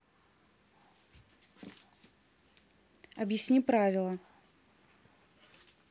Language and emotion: Russian, neutral